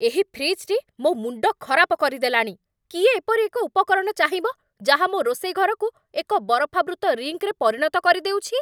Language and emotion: Odia, angry